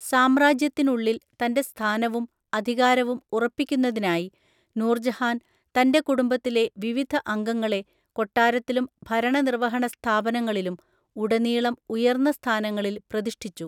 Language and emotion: Malayalam, neutral